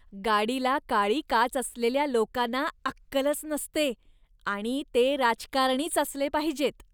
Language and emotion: Marathi, disgusted